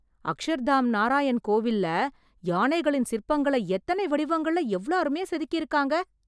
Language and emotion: Tamil, surprised